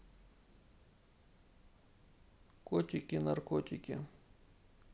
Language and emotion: Russian, neutral